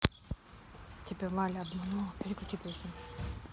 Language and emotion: Russian, neutral